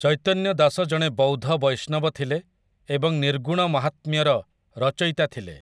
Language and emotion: Odia, neutral